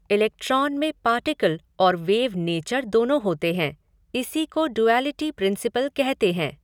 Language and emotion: Hindi, neutral